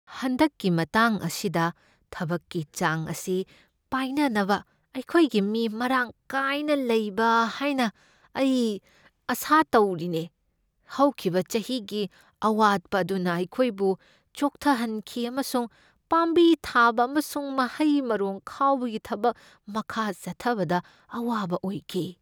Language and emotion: Manipuri, fearful